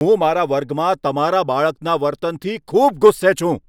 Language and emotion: Gujarati, angry